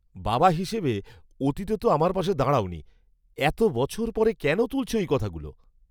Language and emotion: Bengali, surprised